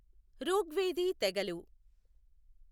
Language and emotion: Telugu, neutral